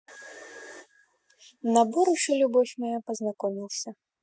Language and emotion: Russian, neutral